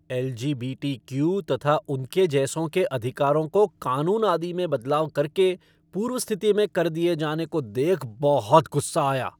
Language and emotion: Hindi, angry